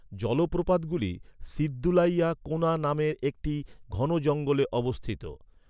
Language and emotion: Bengali, neutral